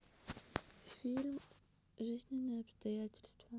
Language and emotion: Russian, neutral